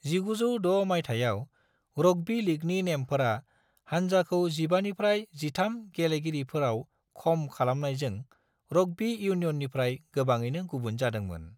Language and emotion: Bodo, neutral